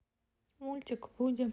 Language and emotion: Russian, neutral